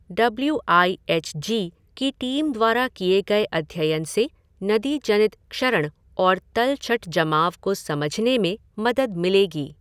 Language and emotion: Hindi, neutral